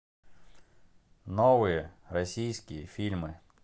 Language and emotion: Russian, neutral